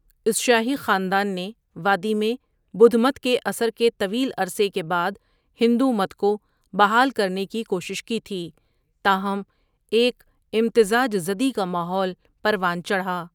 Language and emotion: Urdu, neutral